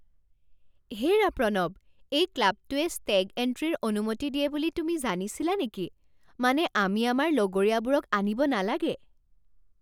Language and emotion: Assamese, surprised